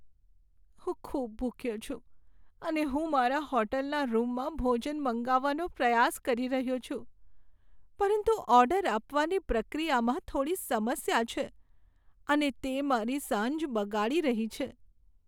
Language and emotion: Gujarati, sad